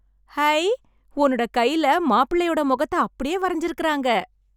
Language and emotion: Tamil, happy